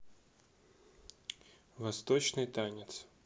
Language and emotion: Russian, neutral